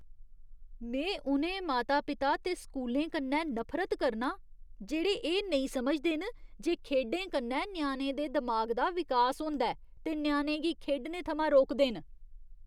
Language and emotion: Dogri, disgusted